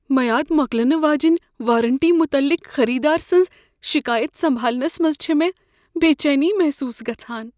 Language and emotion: Kashmiri, fearful